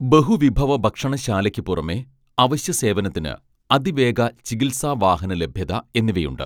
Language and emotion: Malayalam, neutral